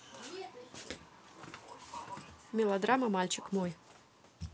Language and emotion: Russian, neutral